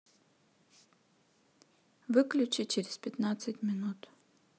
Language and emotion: Russian, neutral